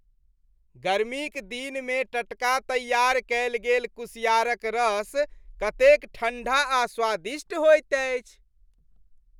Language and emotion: Maithili, happy